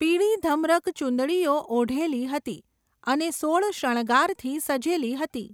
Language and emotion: Gujarati, neutral